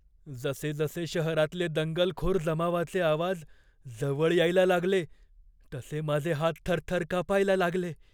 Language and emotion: Marathi, fearful